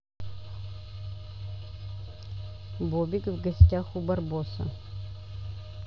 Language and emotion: Russian, neutral